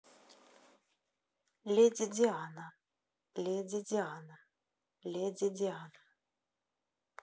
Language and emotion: Russian, neutral